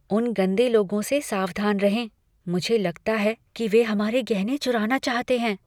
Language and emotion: Hindi, fearful